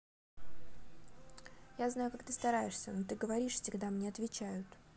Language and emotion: Russian, neutral